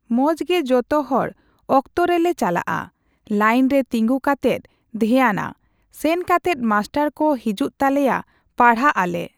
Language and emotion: Santali, neutral